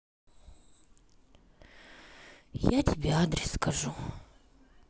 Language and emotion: Russian, sad